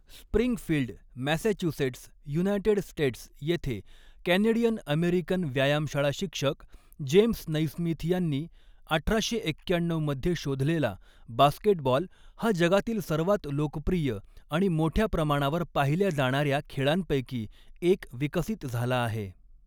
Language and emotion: Marathi, neutral